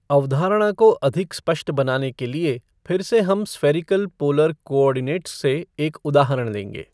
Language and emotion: Hindi, neutral